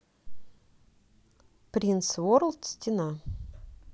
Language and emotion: Russian, neutral